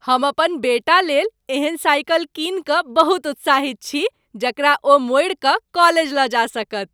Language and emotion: Maithili, happy